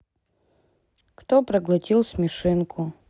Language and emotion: Russian, sad